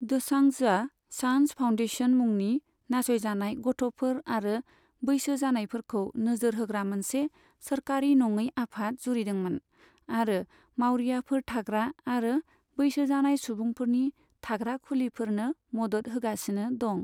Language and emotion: Bodo, neutral